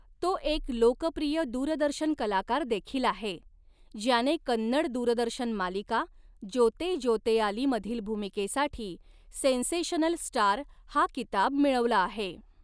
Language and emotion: Marathi, neutral